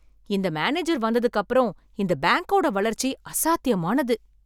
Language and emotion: Tamil, surprised